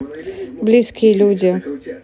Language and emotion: Russian, neutral